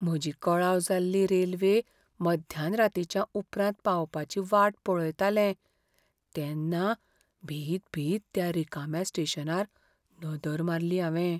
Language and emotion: Goan Konkani, fearful